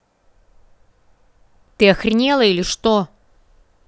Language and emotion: Russian, angry